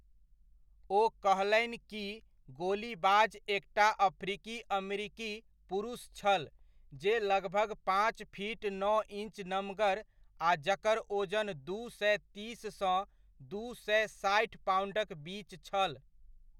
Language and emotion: Maithili, neutral